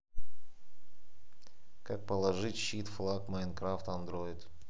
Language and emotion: Russian, neutral